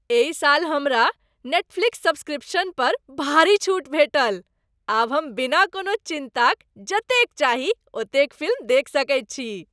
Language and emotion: Maithili, happy